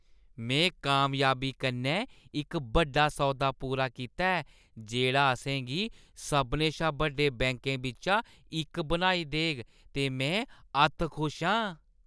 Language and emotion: Dogri, happy